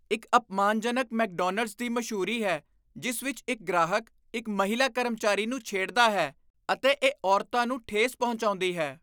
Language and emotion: Punjabi, disgusted